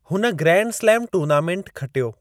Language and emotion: Sindhi, neutral